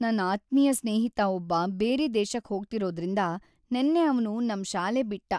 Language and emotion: Kannada, sad